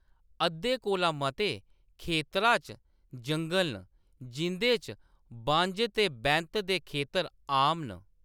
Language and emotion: Dogri, neutral